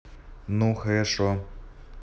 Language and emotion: Russian, neutral